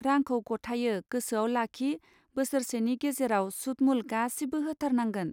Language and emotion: Bodo, neutral